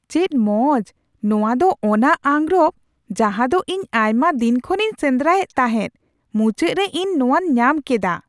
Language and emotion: Santali, surprised